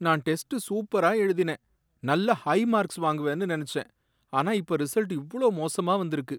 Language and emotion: Tamil, sad